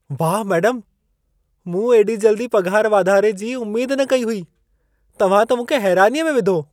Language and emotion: Sindhi, surprised